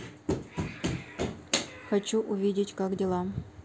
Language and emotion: Russian, neutral